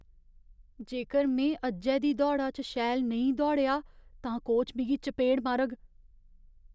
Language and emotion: Dogri, fearful